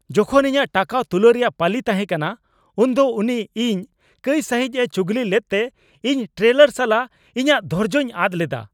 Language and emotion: Santali, angry